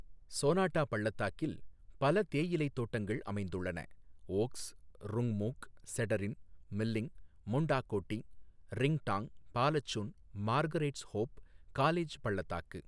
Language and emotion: Tamil, neutral